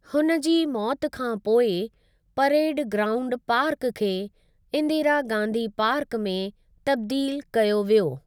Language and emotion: Sindhi, neutral